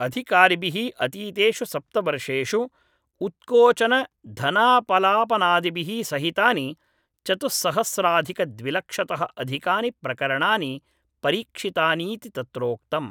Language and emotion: Sanskrit, neutral